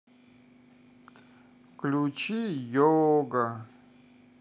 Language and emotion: Russian, sad